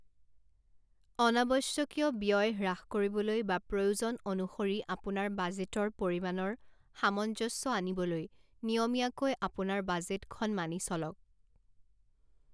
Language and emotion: Assamese, neutral